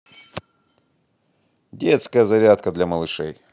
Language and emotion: Russian, positive